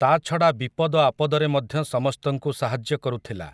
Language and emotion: Odia, neutral